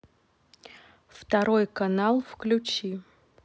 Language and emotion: Russian, neutral